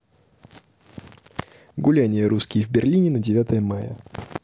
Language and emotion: Russian, neutral